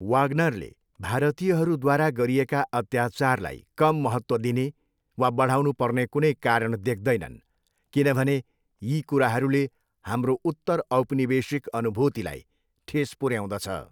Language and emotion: Nepali, neutral